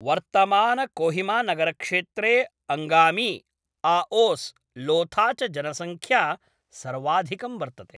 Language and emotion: Sanskrit, neutral